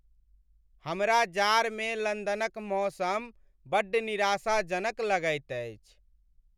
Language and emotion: Maithili, sad